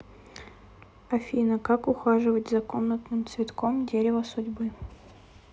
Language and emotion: Russian, sad